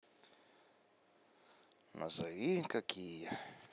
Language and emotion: Russian, neutral